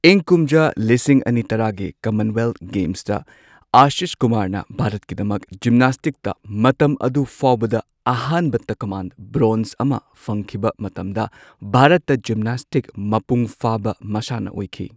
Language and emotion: Manipuri, neutral